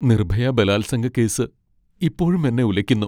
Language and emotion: Malayalam, sad